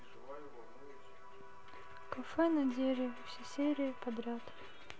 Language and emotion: Russian, sad